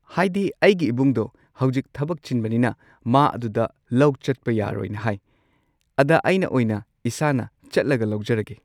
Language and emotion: Manipuri, neutral